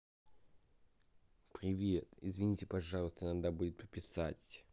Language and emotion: Russian, neutral